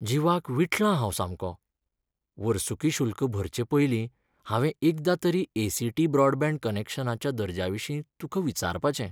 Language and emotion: Goan Konkani, sad